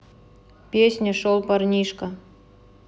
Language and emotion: Russian, neutral